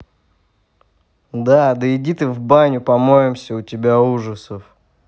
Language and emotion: Russian, angry